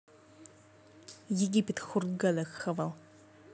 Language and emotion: Russian, angry